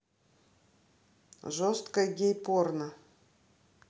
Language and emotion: Russian, neutral